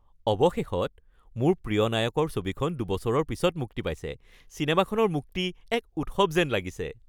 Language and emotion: Assamese, happy